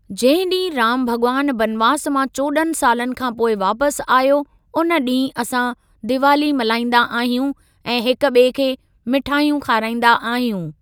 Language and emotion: Sindhi, neutral